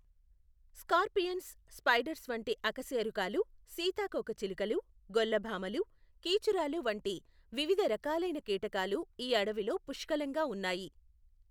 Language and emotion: Telugu, neutral